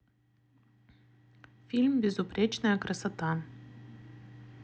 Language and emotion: Russian, neutral